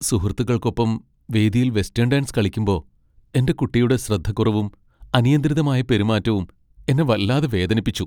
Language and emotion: Malayalam, sad